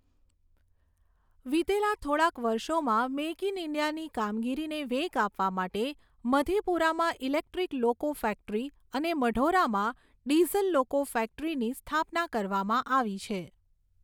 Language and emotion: Gujarati, neutral